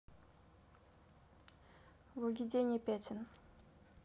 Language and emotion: Russian, neutral